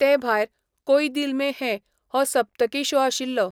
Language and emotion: Goan Konkani, neutral